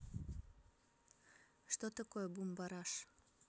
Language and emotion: Russian, neutral